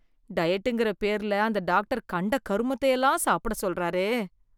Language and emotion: Tamil, disgusted